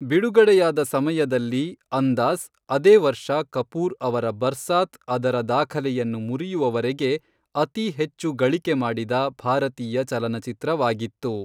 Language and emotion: Kannada, neutral